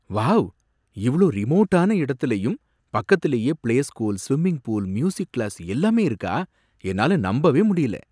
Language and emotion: Tamil, surprised